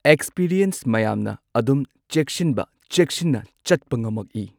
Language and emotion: Manipuri, neutral